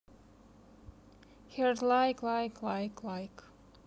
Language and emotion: Russian, neutral